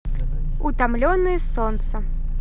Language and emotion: Russian, positive